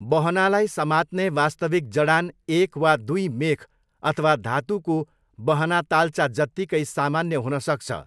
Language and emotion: Nepali, neutral